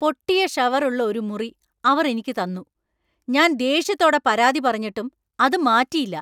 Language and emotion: Malayalam, angry